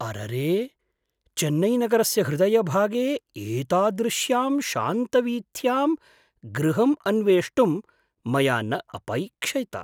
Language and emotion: Sanskrit, surprised